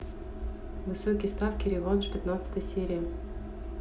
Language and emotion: Russian, neutral